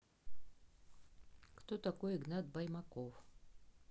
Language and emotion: Russian, neutral